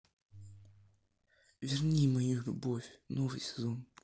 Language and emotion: Russian, neutral